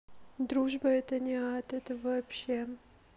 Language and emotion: Russian, sad